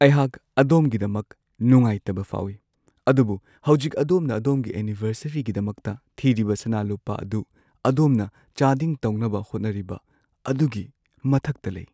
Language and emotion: Manipuri, sad